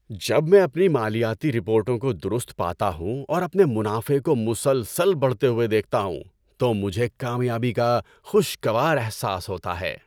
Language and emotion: Urdu, happy